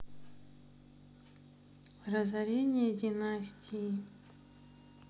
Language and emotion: Russian, sad